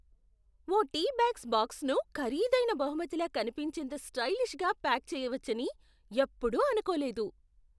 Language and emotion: Telugu, surprised